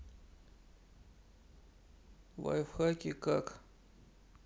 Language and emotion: Russian, sad